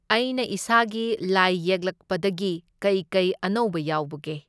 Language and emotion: Manipuri, neutral